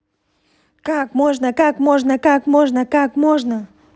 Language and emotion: Russian, angry